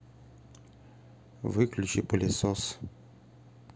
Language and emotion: Russian, neutral